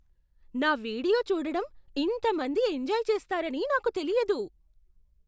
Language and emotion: Telugu, surprised